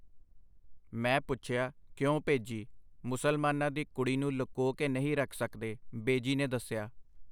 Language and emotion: Punjabi, neutral